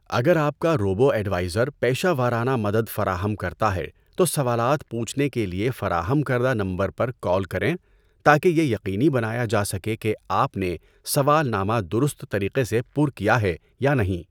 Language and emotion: Urdu, neutral